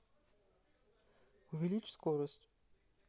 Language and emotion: Russian, neutral